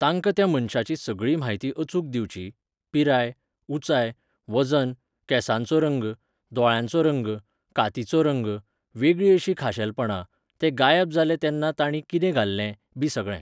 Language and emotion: Goan Konkani, neutral